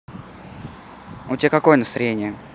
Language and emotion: Russian, neutral